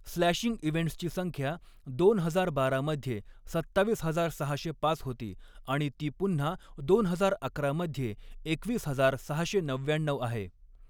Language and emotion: Marathi, neutral